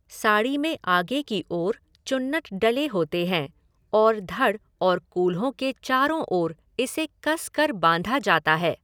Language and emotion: Hindi, neutral